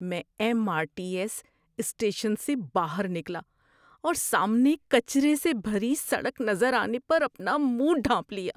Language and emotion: Urdu, disgusted